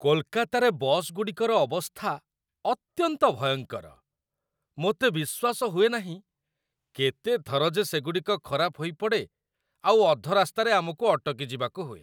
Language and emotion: Odia, disgusted